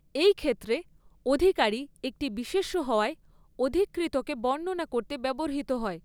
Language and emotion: Bengali, neutral